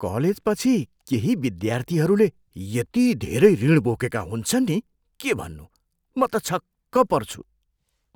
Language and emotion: Nepali, surprised